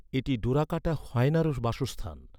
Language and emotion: Bengali, neutral